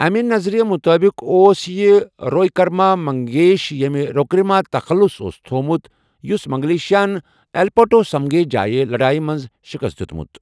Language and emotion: Kashmiri, neutral